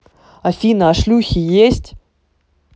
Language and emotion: Russian, neutral